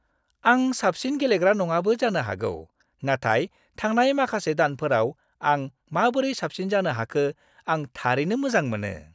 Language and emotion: Bodo, happy